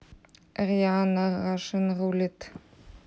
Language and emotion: Russian, neutral